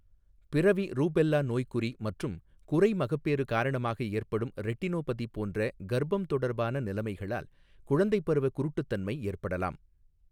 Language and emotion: Tamil, neutral